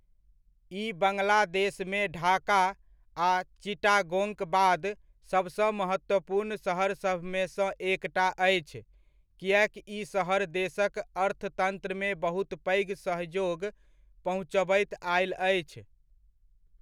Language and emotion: Maithili, neutral